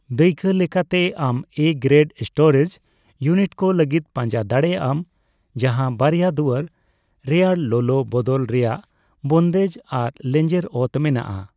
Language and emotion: Santali, neutral